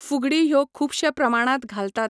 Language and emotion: Goan Konkani, neutral